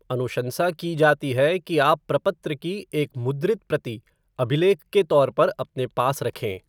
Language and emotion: Hindi, neutral